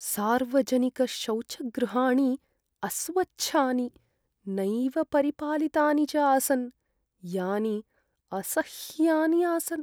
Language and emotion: Sanskrit, sad